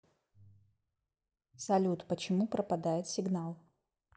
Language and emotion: Russian, neutral